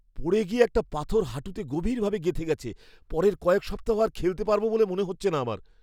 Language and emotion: Bengali, fearful